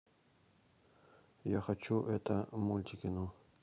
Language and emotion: Russian, neutral